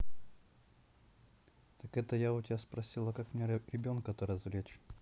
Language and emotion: Russian, neutral